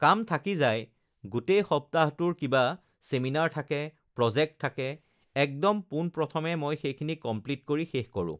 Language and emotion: Assamese, neutral